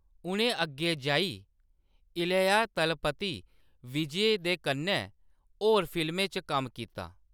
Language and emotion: Dogri, neutral